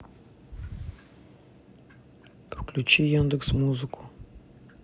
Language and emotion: Russian, neutral